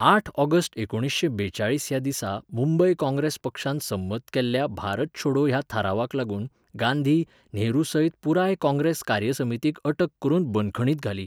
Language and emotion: Goan Konkani, neutral